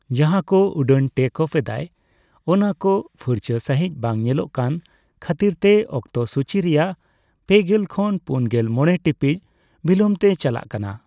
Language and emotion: Santali, neutral